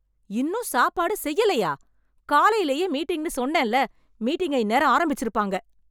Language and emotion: Tamil, angry